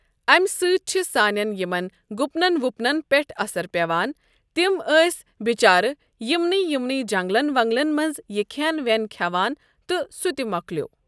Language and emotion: Kashmiri, neutral